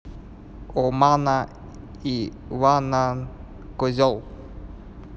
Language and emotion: Russian, neutral